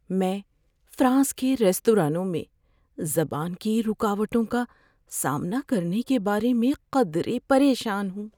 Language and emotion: Urdu, fearful